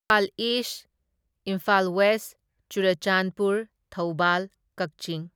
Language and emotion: Manipuri, neutral